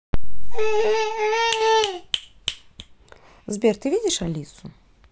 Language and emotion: Russian, neutral